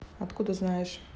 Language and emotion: Russian, neutral